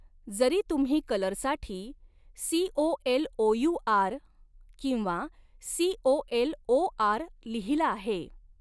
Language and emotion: Marathi, neutral